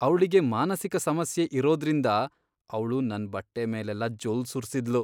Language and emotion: Kannada, disgusted